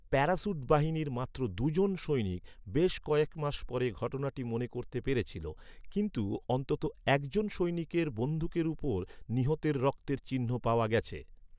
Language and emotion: Bengali, neutral